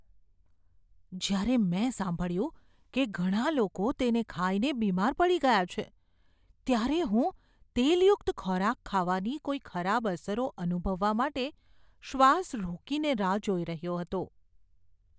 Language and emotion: Gujarati, fearful